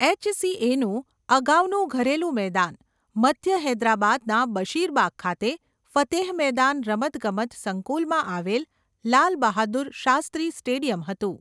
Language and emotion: Gujarati, neutral